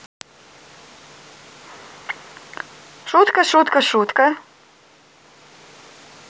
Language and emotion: Russian, positive